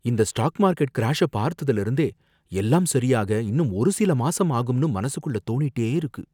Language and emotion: Tamil, fearful